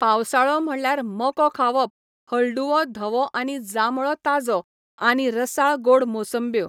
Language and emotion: Goan Konkani, neutral